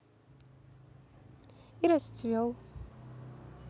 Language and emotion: Russian, positive